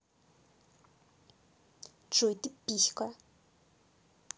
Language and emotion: Russian, angry